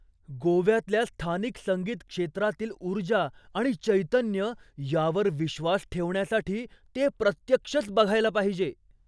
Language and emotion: Marathi, surprised